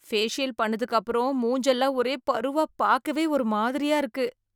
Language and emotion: Tamil, disgusted